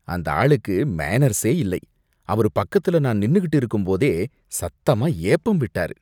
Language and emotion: Tamil, disgusted